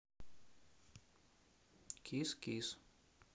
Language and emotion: Russian, neutral